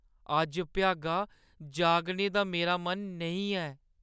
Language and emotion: Dogri, sad